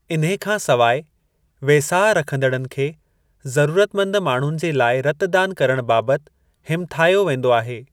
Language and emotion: Sindhi, neutral